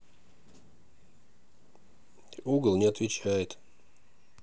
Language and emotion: Russian, neutral